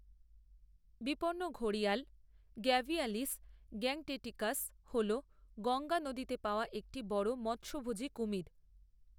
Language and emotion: Bengali, neutral